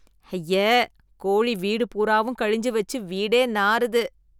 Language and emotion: Tamil, disgusted